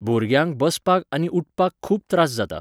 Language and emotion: Goan Konkani, neutral